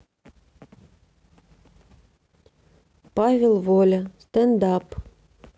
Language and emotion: Russian, neutral